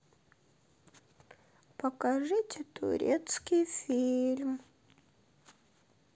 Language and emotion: Russian, sad